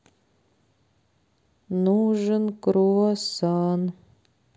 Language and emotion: Russian, sad